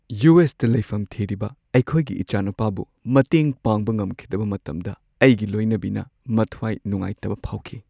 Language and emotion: Manipuri, sad